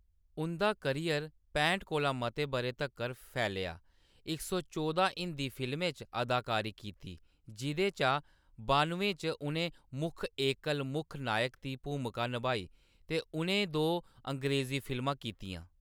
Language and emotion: Dogri, neutral